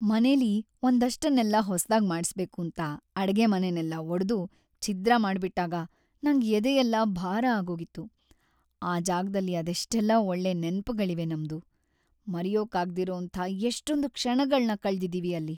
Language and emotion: Kannada, sad